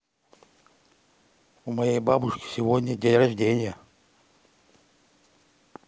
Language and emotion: Russian, neutral